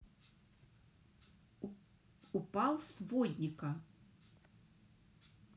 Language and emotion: Russian, neutral